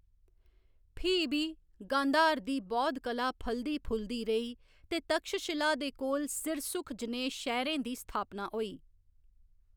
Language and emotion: Dogri, neutral